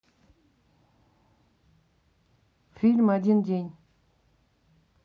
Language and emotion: Russian, neutral